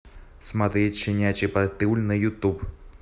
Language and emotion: Russian, neutral